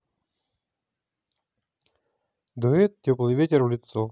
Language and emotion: Russian, positive